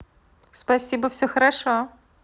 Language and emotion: Russian, positive